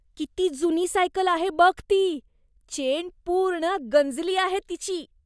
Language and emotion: Marathi, disgusted